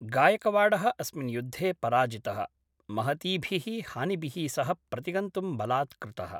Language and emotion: Sanskrit, neutral